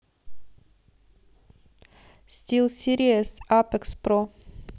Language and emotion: Russian, neutral